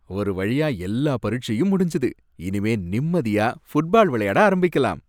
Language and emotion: Tamil, happy